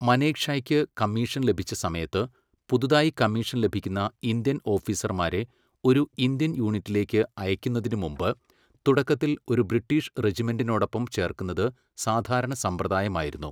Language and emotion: Malayalam, neutral